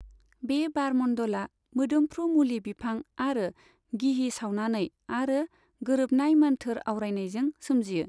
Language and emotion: Bodo, neutral